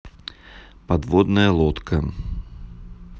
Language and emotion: Russian, neutral